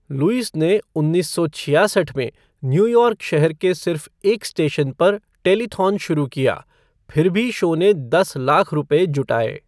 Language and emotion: Hindi, neutral